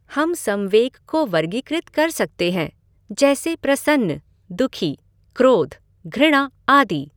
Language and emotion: Hindi, neutral